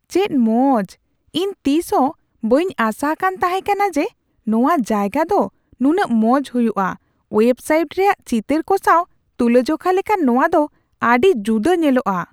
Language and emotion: Santali, surprised